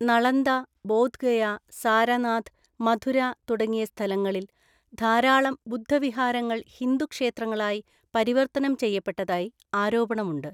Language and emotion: Malayalam, neutral